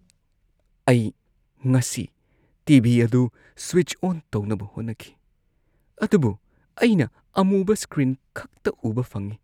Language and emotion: Manipuri, sad